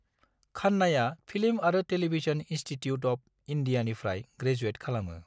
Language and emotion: Bodo, neutral